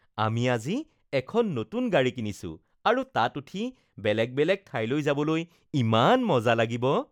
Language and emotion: Assamese, happy